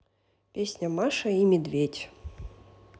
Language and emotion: Russian, neutral